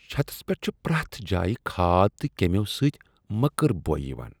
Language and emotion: Kashmiri, disgusted